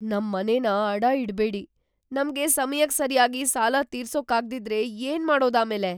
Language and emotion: Kannada, fearful